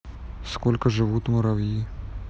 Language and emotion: Russian, neutral